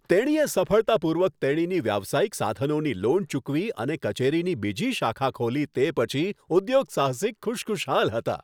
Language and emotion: Gujarati, happy